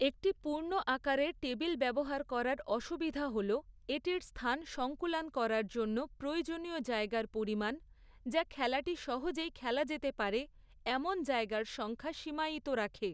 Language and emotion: Bengali, neutral